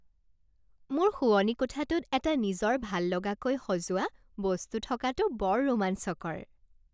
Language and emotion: Assamese, happy